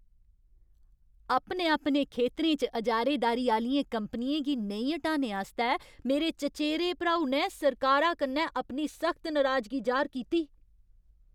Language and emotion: Dogri, angry